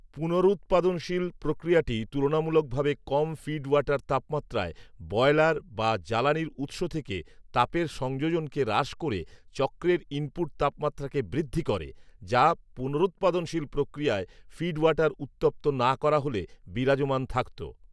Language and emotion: Bengali, neutral